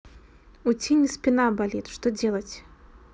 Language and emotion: Russian, neutral